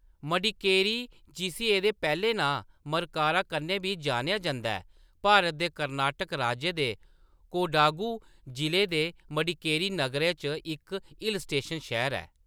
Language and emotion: Dogri, neutral